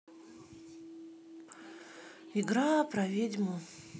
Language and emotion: Russian, sad